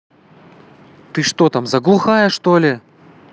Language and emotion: Russian, angry